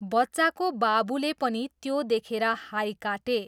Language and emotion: Nepali, neutral